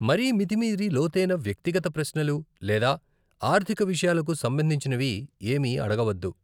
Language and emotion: Telugu, neutral